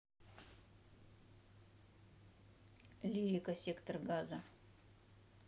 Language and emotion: Russian, neutral